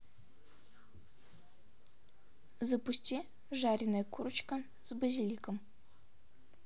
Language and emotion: Russian, neutral